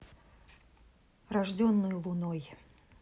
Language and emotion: Russian, neutral